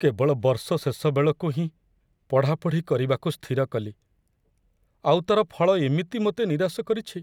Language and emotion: Odia, sad